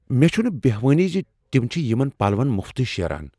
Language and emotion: Kashmiri, surprised